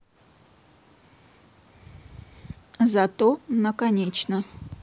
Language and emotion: Russian, neutral